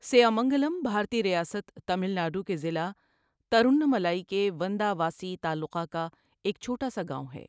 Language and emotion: Urdu, neutral